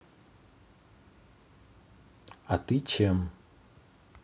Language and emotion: Russian, neutral